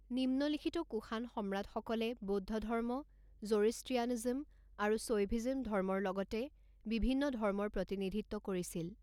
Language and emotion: Assamese, neutral